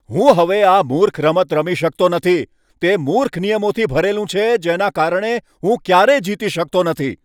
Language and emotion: Gujarati, angry